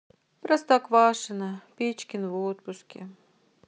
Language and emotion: Russian, sad